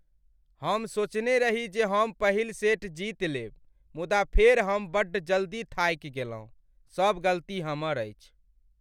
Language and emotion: Maithili, sad